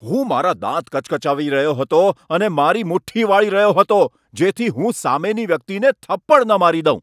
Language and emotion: Gujarati, angry